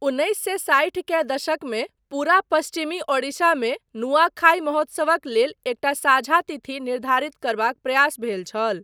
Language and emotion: Maithili, neutral